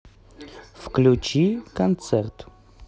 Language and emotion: Russian, neutral